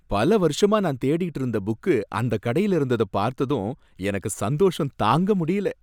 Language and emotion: Tamil, happy